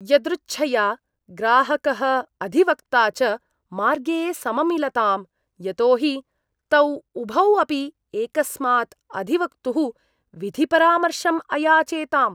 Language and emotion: Sanskrit, disgusted